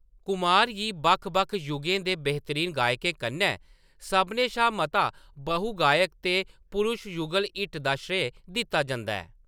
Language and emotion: Dogri, neutral